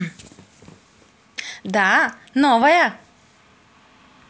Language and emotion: Russian, positive